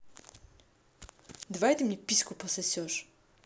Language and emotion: Russian, neutral